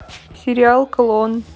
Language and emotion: Russian, neutral